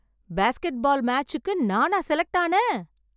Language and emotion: Tamil, surprised